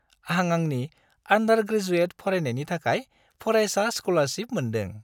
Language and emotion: Bodo, happy